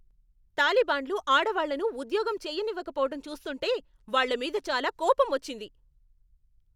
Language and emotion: Telugu, angry